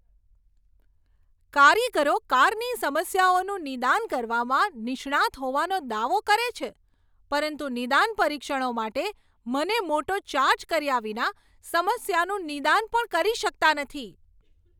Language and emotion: Gujarati, angry